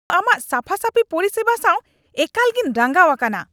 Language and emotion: Santali, angry